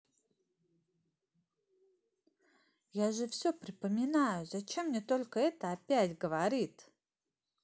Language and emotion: Russian, neutral